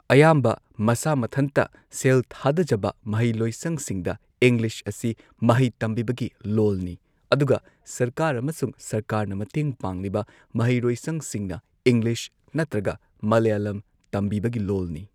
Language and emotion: Manipuri, neutral